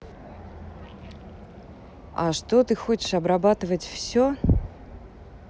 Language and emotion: Russian, neutral